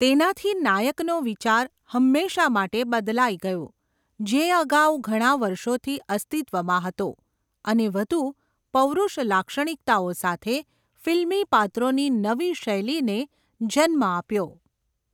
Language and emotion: Gujarati, neutral